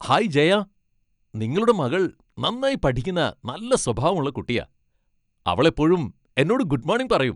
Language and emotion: Malayalam, happy